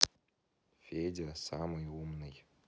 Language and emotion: Russian, neutral